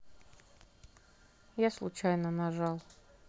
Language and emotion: Russian, neutral